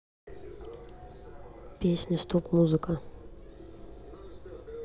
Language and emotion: Russian, neutral